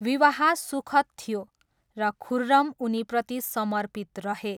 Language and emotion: Nepali, neutral